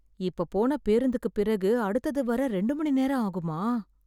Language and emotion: Tamil, fearful